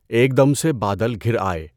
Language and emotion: Urdu, neutral